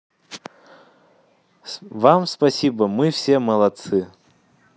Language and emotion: Russian, positive